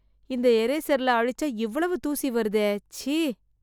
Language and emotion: Tamil, disgusted